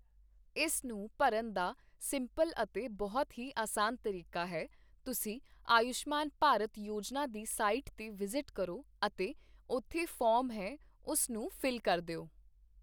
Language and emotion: Punjabi, neutral